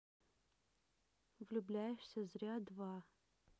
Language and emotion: Russian, neutral